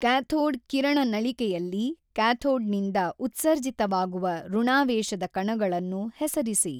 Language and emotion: Kannada, neutral